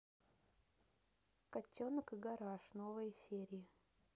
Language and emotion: Russian, neutral